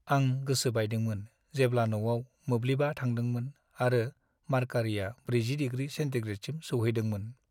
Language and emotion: Bodo, sad